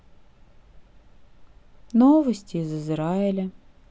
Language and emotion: Russian, sad